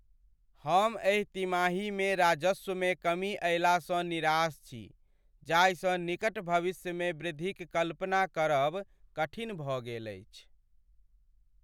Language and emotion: Maithili, sad